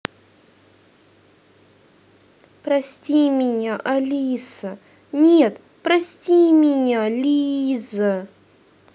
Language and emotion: Russian, sad